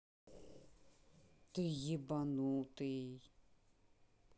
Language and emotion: Russian, angry